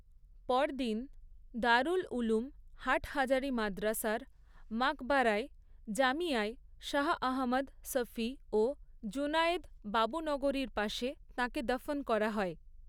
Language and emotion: Bengali, neutral